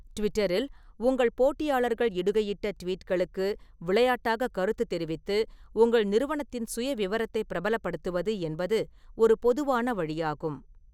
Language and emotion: Tamil, neutral